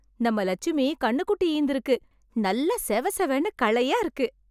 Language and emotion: Tamil, happy